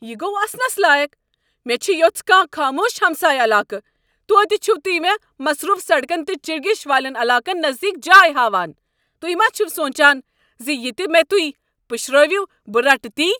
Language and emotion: Kashmiri, angry